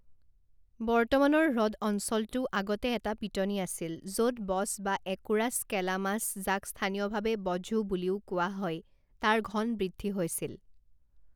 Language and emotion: Assamese, neutral